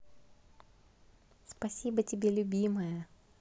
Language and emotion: Russian, positive